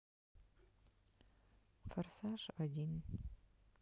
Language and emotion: Russian, sad